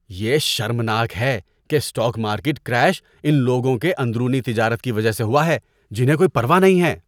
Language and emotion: Urdu, disgusted